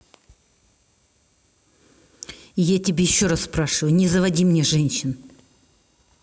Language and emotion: Russian, angry